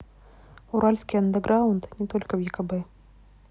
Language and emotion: Russian, neutral